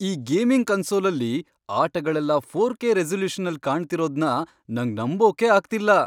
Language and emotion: Kannada, surprised